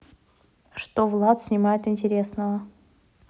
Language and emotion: Russian, neutral